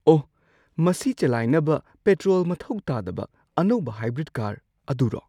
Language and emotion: Manipuri, surprised